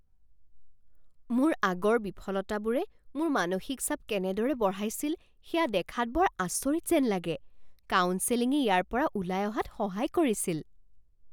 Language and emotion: Assamese, surprised